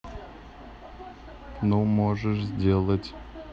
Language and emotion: Russian, neutral